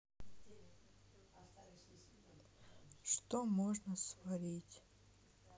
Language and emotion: Russian, sad